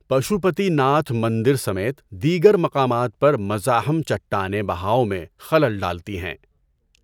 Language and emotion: Urdu, neutral